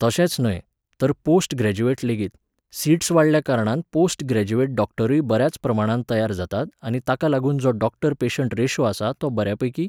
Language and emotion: Goan Konkani, neutral